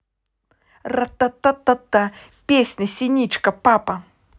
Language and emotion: Russian, positive